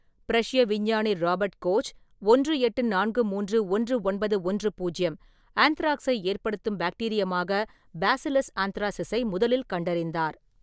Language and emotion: Tamil, neutral